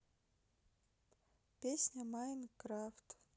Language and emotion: Russian, sad